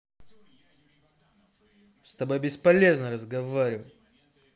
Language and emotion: Russian, angry